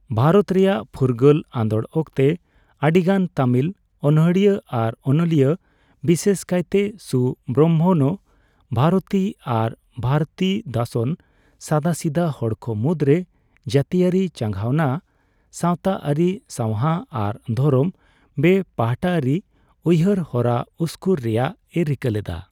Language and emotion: Santali, neutral